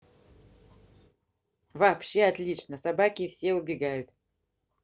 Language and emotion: Russian, positive